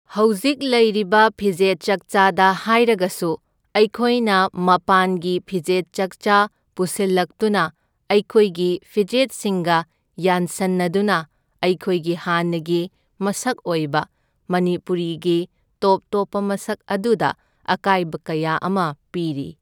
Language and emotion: Manipuri, neutral